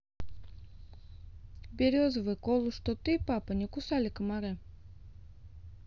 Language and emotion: Russian, neutral